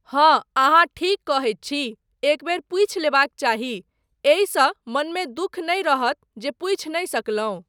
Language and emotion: Maithili, neutral